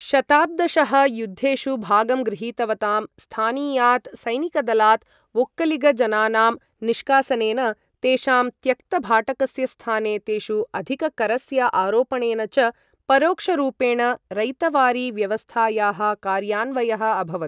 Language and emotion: Sanskrit, neutral